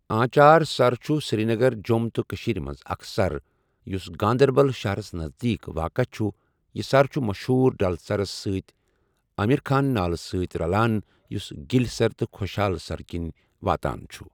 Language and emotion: Kashmiri, neutral